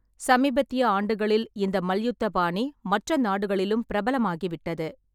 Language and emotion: Tamil, neutral